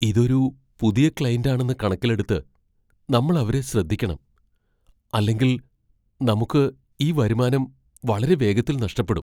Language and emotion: Malayalam, fearful